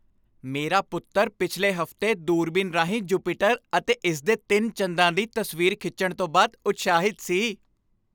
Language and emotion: Punjabi, happy